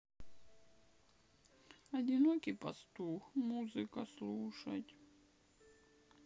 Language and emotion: Russian, sad